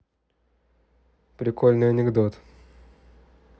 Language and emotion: Russian, neutral